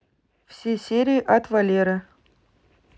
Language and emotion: Russian, neutral